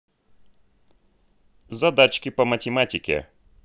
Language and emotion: Russian, neutral